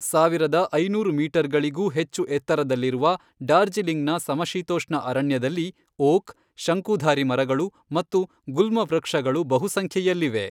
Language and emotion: Kannada, neutral